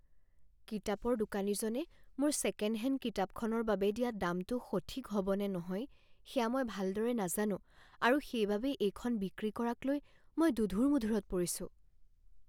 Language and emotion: Assamese, fearful